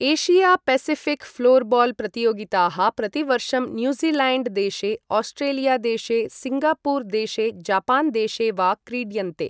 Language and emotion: Sanskrit, neutral